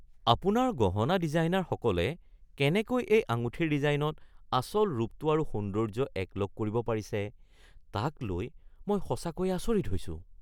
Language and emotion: Assamese, surprised